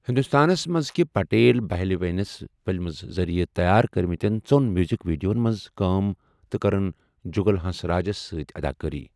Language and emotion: Kashmiri, neutral